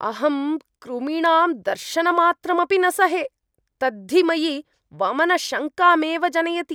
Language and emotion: Sanskrit, disgusted